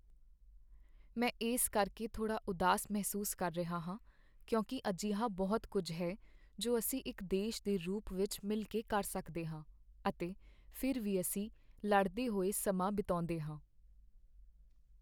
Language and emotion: Punjabi, sad